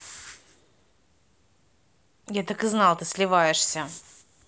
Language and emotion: Russian, angry